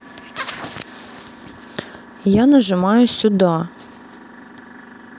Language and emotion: Russian, neutral